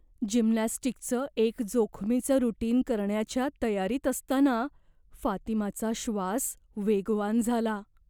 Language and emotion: Marathi, fearful